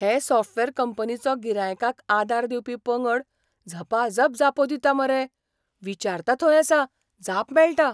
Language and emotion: Goan Konkani, surprised